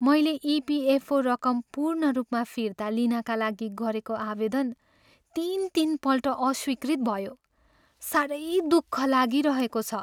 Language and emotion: Nepali, sad